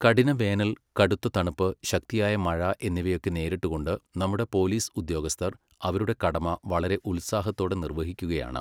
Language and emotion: Malayalam, neutral